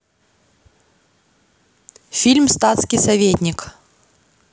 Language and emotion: Russian, neutral